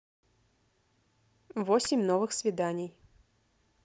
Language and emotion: Russian, neutral